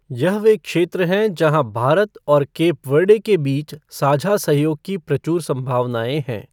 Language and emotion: Hindi, neutral